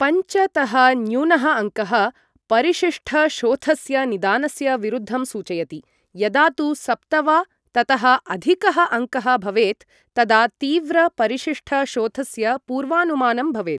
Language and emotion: Sanskrit, neutral